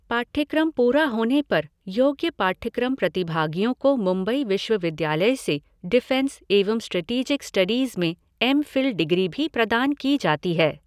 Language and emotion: Hindi, neutral